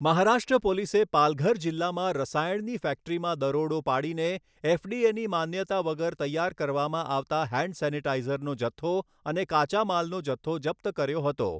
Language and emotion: Gujarati, neutral